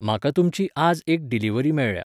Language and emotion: Goan Konkani, neutral